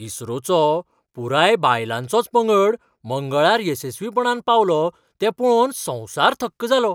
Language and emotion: Goan Konkani, surprised